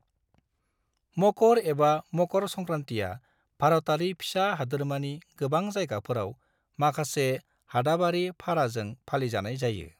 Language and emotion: Bodo, neutral